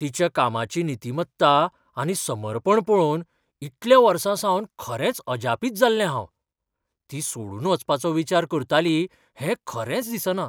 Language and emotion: Goan Konkani, surprised